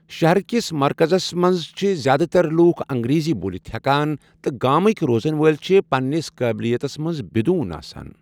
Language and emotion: Kashmiri, neutral